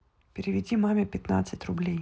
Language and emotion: Russian, neutral